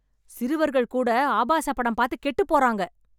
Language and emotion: Tamil, angry